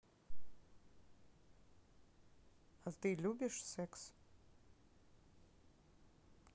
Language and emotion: Russian, neutral